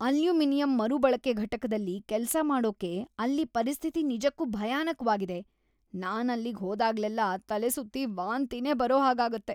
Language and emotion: Kannada, disgusted